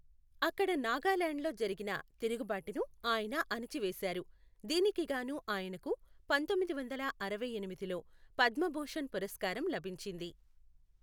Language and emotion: Telugu, neutral